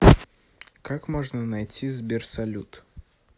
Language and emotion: Russian, neutral